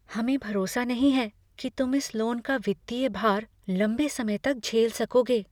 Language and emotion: Hindi, fearful